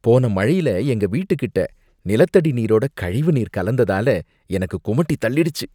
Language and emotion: Tamil, disgusted